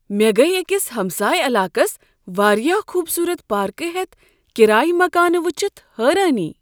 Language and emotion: Kashmiri, surprised